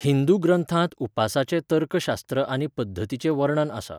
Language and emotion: Goan Konkani, neutral